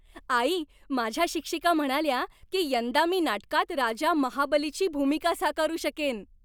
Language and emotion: Marathi, happy